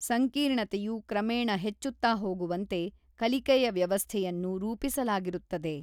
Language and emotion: Kannada, neutral